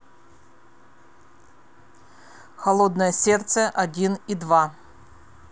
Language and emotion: Russian, angry